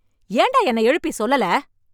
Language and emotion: Tamil, angry